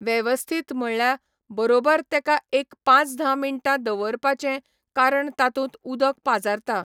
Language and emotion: Goan Konkani, neutral